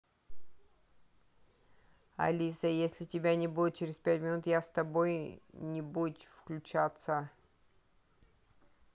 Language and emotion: Russian, neutral